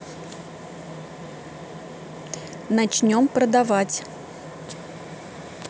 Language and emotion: Russian, neutral